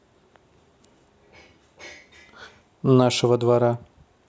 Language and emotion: Russian, neutral